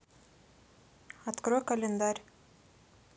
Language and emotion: Russian, neutral